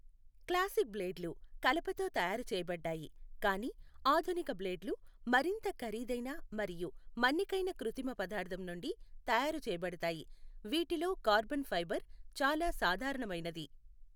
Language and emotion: Telugu, neutral